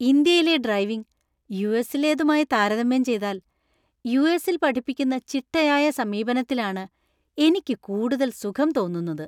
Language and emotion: Malayalam, happy